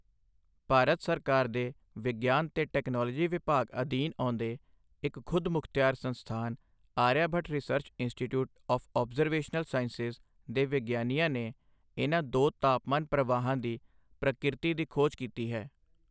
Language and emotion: Punjabi, neutral